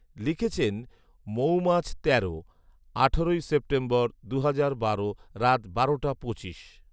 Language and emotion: Bengali, neutral